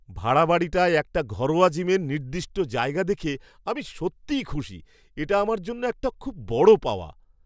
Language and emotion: Bengali, surprised